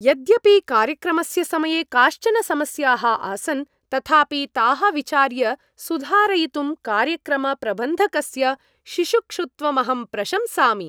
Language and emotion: Sanskrit, happy